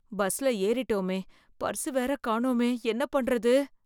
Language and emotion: Tamil, fearful